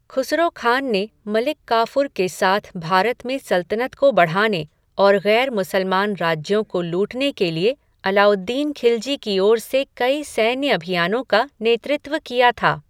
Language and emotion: Hindi, neutral